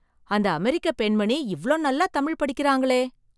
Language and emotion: Tamil, surprised